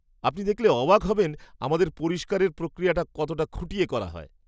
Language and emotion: Bengali, surprised